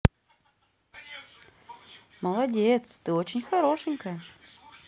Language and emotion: Russian, positive